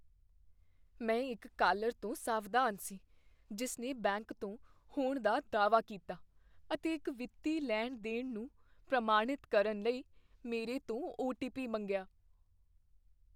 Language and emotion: Punjabi, fearful